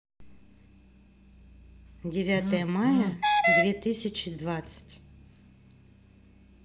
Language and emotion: Russian, neutral